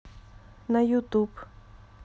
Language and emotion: Russian, neutral